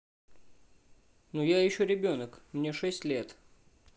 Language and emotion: Russian, neutral